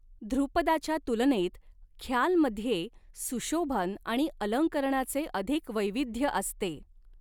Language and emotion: Marathi, neutral